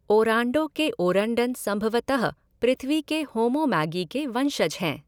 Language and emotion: Hindi, neutral